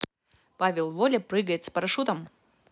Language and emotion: Russian, positive